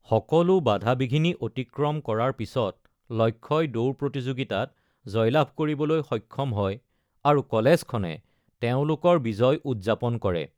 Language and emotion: Assamese, neutral